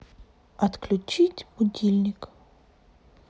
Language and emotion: Russian, neutral